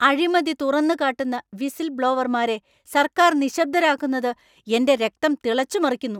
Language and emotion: Malayalam, angry